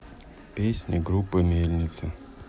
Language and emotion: Russian, neutral